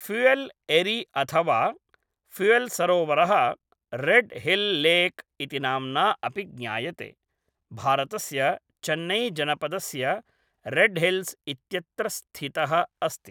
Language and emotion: Sanskrit, neutral